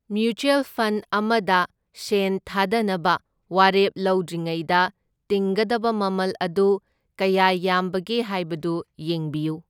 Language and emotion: Manipuri, neutral